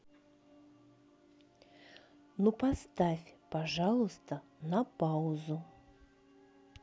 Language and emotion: Russian, neutral